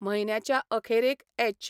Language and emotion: Goan Konkani, neutral